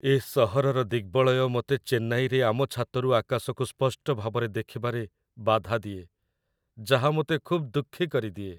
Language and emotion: Odia, sad